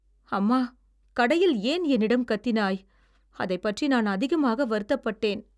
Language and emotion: Tamil, sad